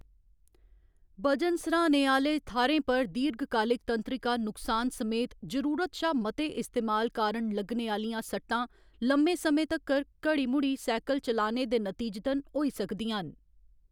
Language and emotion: Dogri, neutral